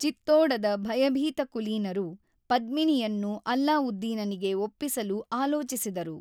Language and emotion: Kannada, neutral